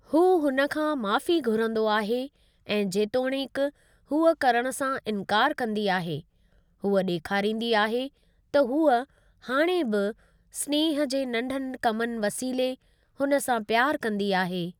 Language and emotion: Sindhi, neutral